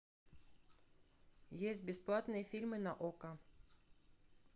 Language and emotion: Russian, neutral